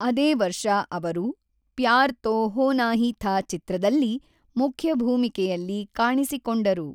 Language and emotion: Kannada, neutral